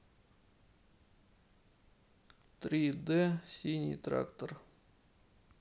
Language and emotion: Russian, neutral